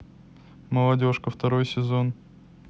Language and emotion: Russian, neutral